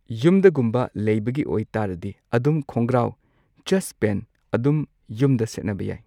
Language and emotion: Manipuri, neutral